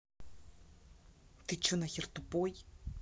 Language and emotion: Russian, angry